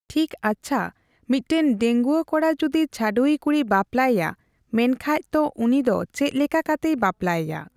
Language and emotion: Santali, neutral